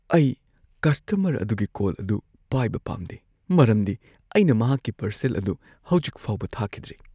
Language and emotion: Manipuri, fearful